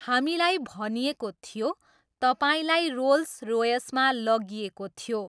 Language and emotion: Nepali, neutral